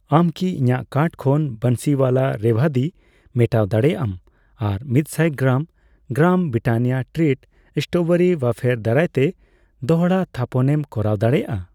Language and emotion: Santali, neutral